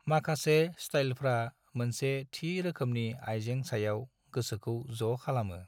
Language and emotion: Bodo, neutral